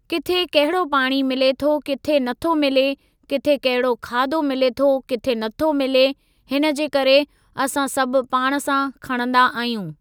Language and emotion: Sindhi, neutral